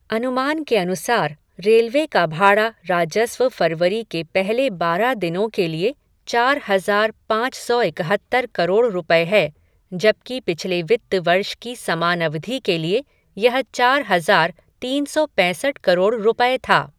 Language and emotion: Hindi, neutral